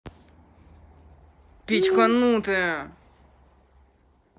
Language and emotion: Russian, angry